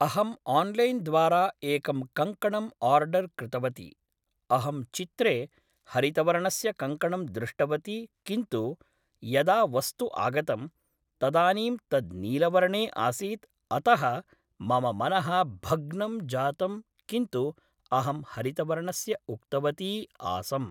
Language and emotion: Sanskrit, neutral